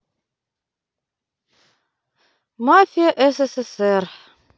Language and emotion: Russian, sad